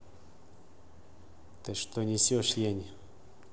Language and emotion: Russian, angry